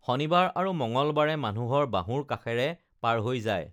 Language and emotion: Assamese, neutral